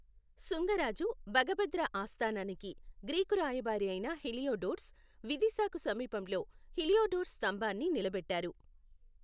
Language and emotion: Telugu, neutral